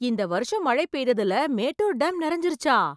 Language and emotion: Tamil, surprised